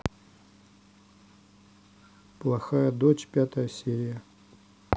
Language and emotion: Russian, neutral